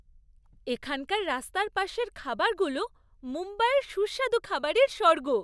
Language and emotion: Bengali, happy